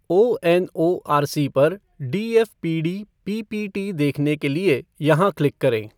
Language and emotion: Hindi, neutral